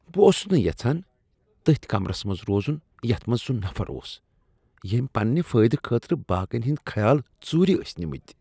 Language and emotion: Kashmiri, disgusted